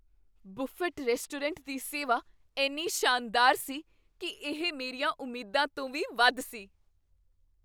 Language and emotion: Punjabi, surprised